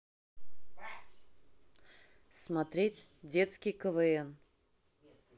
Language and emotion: Russian, neutral